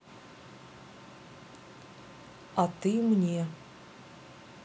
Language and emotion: Russian, neutral